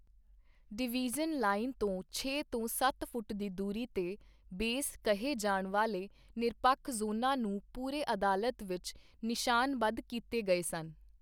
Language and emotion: Punjabi, neutral